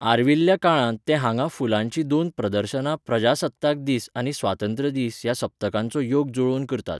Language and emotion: Goan Konkani, neutral